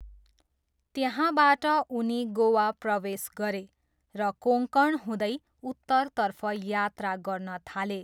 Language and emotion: Nepali, neutral